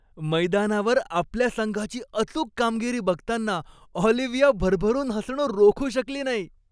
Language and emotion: Marathi, happy